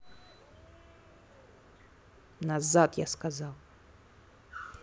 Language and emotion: Russian, angry